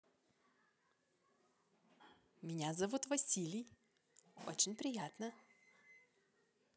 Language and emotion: Russian, positive